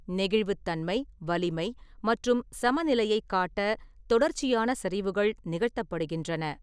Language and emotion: Tamil, neutral